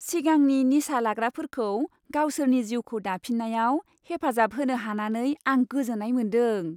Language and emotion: Bodo, happy